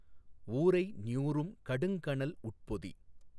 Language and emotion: Tamil, neutral